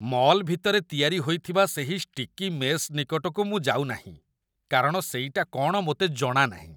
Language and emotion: Odia, disgusted